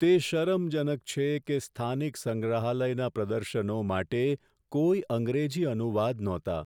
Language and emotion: Gujarati, sad